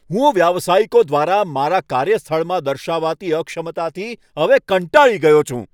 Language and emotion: Gujarati, angry